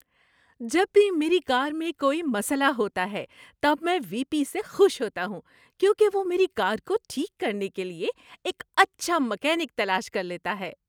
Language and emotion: Urdu, happy